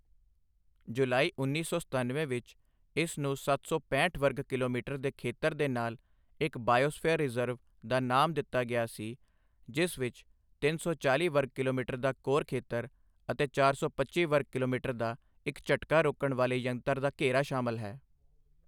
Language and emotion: Punjabi, neutral